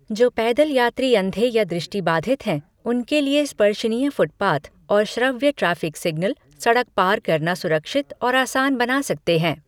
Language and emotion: Hindi, neutral